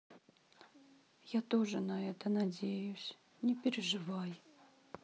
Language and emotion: Russian, sad